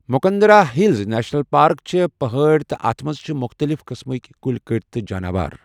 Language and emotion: Kashmiri, neutral